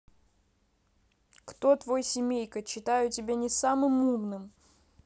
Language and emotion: Russian, neutral